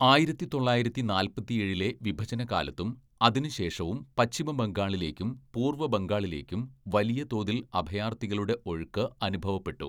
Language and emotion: Malayalam, neutral